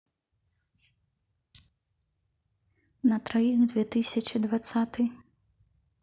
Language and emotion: Russian, neutral